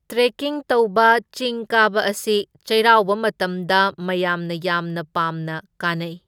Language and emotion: Manipuri, neutral